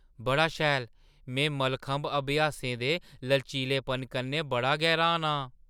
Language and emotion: Dogri, surprised